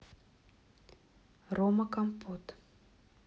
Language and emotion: Russian, neutral